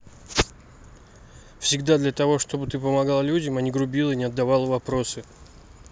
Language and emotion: Russian, neutral